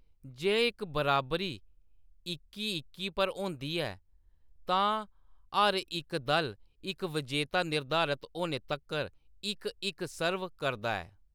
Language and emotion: Dogri, neutral